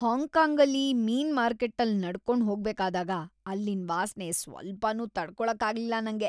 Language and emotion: Kannada, disgusted